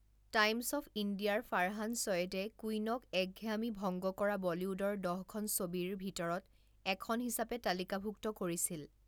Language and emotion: Assamese, neutral